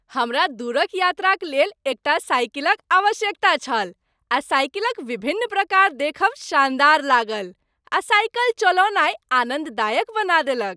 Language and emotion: Maithili, happy